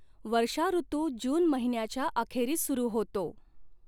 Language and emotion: Marathi, neutral